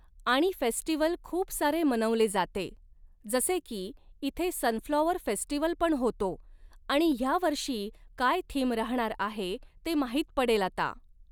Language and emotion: Marathi, neutral